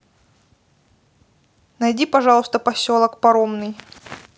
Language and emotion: Russian, neutral